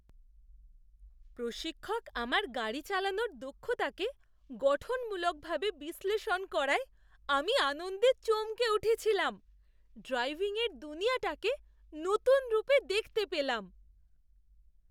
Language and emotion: Bengali, surprised